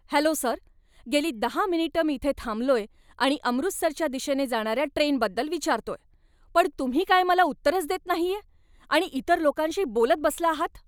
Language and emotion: Marathi, angry